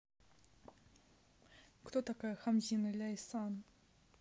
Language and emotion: Russian, neutral